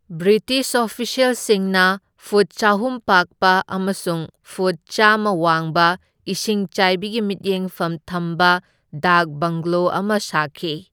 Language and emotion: Manipuri, neutral